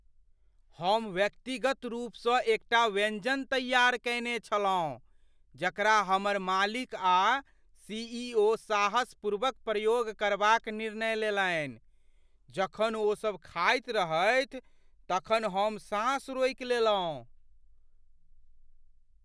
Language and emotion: Maithili, fearful